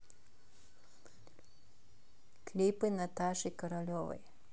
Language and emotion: Russian, neutral